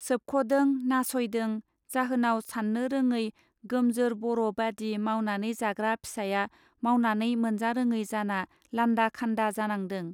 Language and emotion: Bodo, neutral